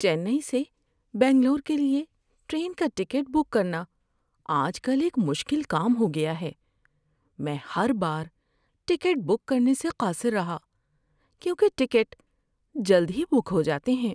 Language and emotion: Urdu, sad